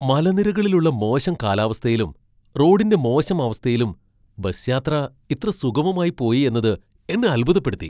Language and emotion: Malayalam, surprised